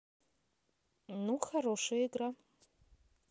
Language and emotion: Russian, neutral